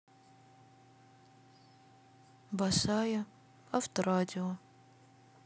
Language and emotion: Russian, sad